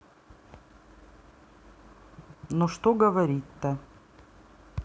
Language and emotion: Russian, neutral